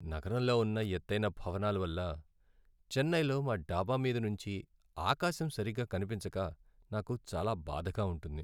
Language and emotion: Telugu, sad